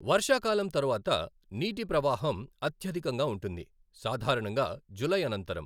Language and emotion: Telugu, neutral